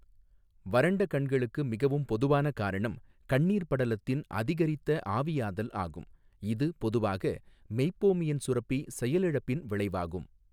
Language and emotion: Tamil, neutral